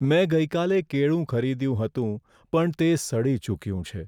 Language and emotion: Gujarati, sad